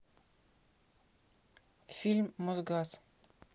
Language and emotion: Russian, neutral